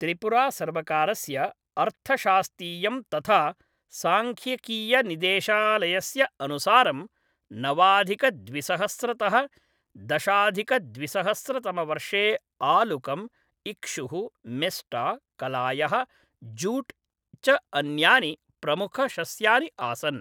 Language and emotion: Sanskrit, neutral